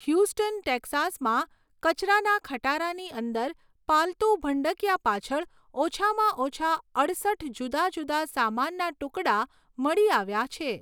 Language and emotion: Gujarati, neutral